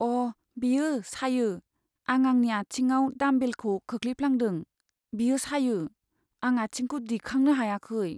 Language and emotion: Bodo, sad